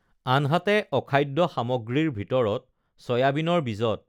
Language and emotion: Assamese, neutral